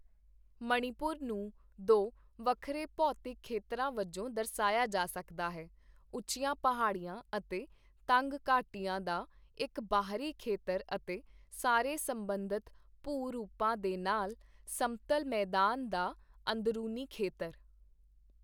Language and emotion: Punjabi, neutral